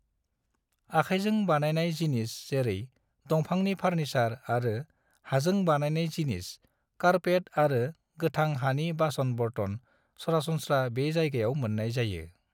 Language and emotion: Bodo, neutral